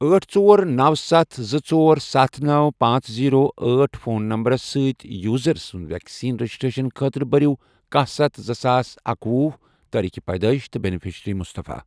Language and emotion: Kashmiri, neutral